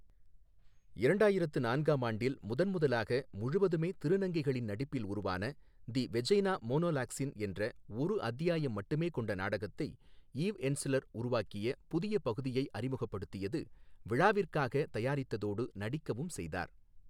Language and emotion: Tamil, neutral